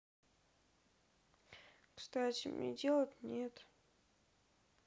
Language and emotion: Russian, sad